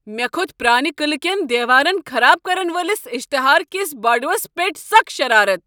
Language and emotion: Kashmiri, angry